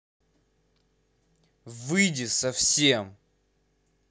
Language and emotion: Russian, angry